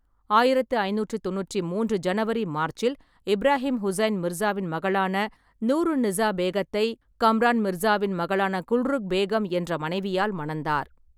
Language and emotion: Tamil, neutral